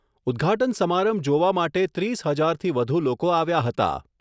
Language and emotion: Gujarati, neutral